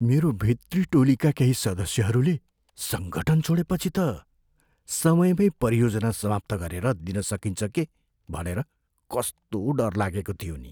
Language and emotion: Nepali, fearful